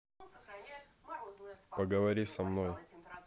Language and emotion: Russian, neutral